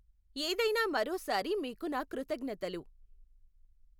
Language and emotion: Telugu, neutral